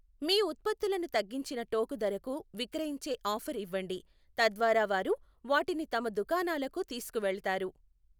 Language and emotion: Telugu, neutral